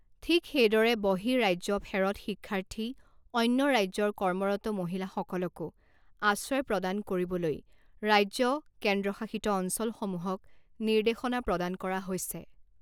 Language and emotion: Assamese, neutral